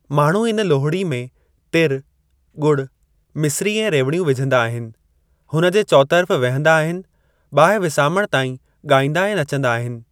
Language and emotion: Sindhi, neutral